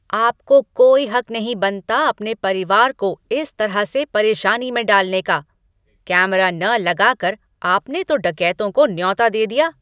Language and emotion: Hindi, angry